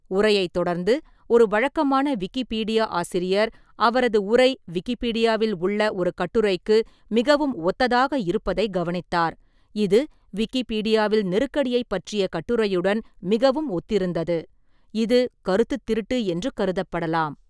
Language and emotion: Tamil, neutral